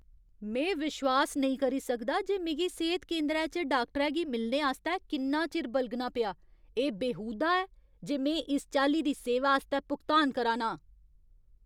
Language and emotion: Dogri, angry